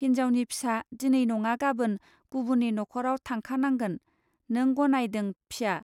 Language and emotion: Bodo, neutral